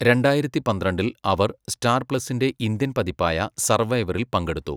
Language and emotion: Malayalam, neutral